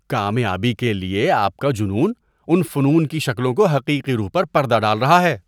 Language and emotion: Urdu, disgusted